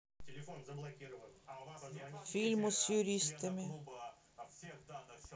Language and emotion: Russian, neutral